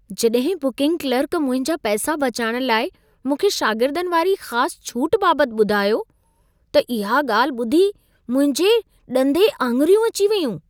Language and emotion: Sindhi, surprised